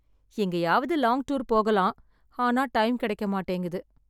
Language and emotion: Tamil, sad